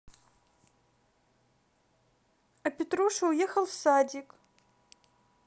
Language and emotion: Russian, neutral